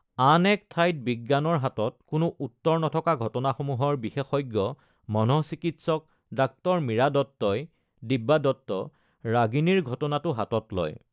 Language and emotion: Assamese, neutral